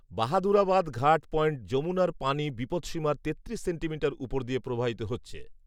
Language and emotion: Bengali, neutral